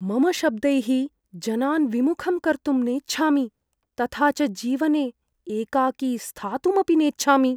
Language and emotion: Sanskrit, fearful